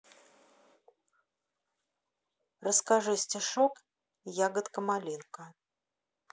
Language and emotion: Russian, neutral